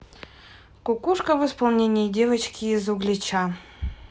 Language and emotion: Russian, neutral